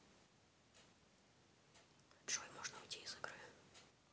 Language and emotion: Russian, neutral